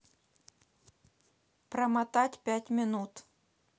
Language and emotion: Russian, neutral